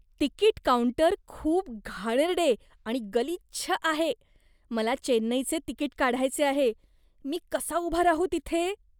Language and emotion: Marathi, disgusted